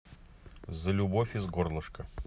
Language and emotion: Russian, neutral